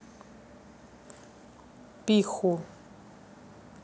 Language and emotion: Russian, neutral